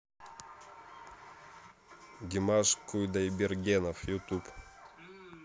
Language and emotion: Russian, neutral